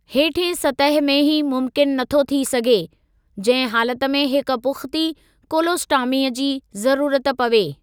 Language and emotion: Sindhi, neutral